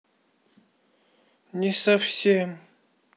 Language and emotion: Russian, sad